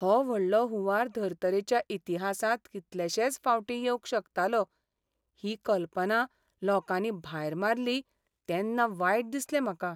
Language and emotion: Goan Konkani, sad